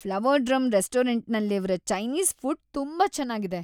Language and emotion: Kannada, happy